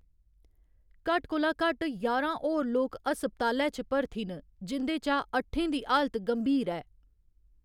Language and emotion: Dogri, neutral